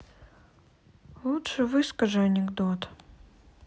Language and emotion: Russian, sad